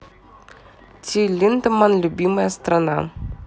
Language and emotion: Russian, neutral